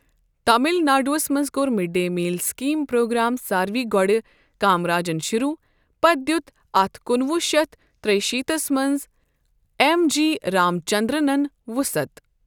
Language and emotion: Kashmiri, neutral